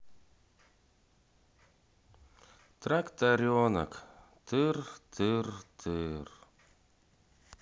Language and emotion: Russian, sad